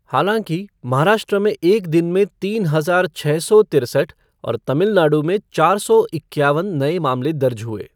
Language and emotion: Hindi, neutral